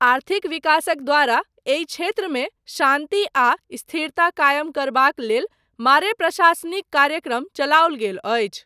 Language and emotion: Maithili, neutral